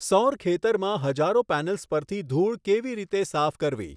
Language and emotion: Gujarati, neutral